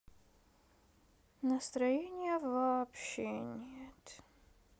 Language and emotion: Russian, sad